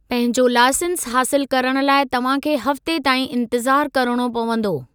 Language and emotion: Sindhi, neutral